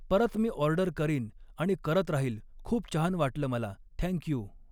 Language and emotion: Marathi, neutral